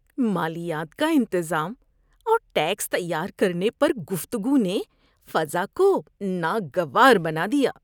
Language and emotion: Urdu, disgusted